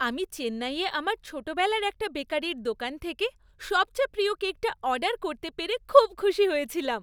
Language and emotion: Bengali, happy